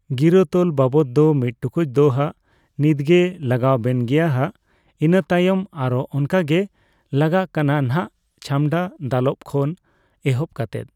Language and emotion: Santali, neutral